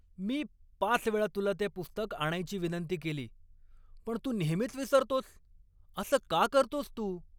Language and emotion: Marathi, angry